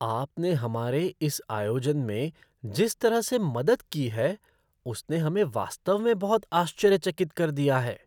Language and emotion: Hindi, surprised